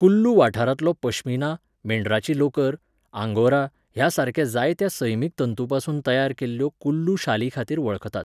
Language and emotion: Goan Konkani, neutral